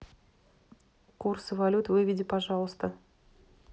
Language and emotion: Russian, neutral